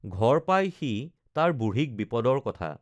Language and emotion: Assamese, neutral